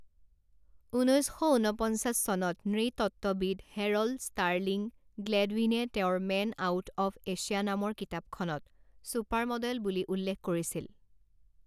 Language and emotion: Assamese, neutral